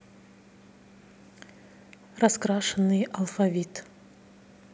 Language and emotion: Russian, neutral